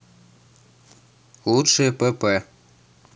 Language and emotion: Russian, neutral